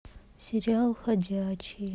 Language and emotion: Russian, sad